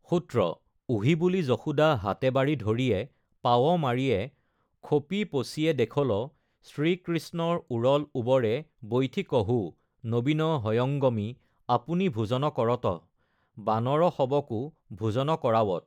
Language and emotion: Assamese, neutral